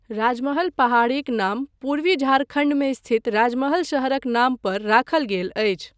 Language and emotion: Maithili, neutral